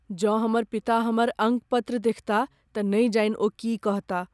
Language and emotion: Maithili, fearful